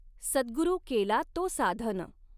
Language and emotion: Marathi, neutral